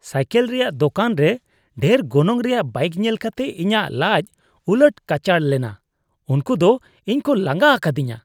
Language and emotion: Santali, disgusted